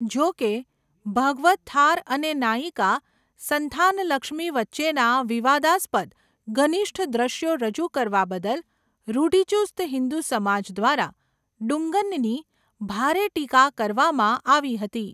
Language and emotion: Gujarati, neutral